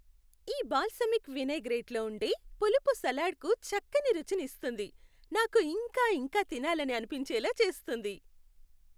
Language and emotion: Telugu, happy